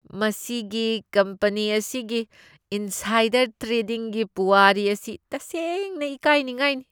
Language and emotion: Manipuri, disgusted